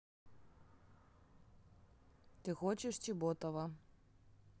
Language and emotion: Russian, neutral